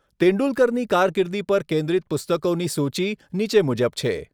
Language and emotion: Gujarati, neutral